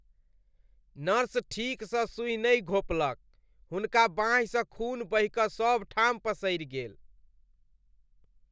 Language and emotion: Maithili, disgusted